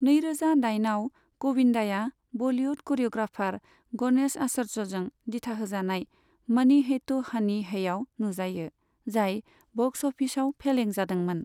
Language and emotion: Bodo, neutral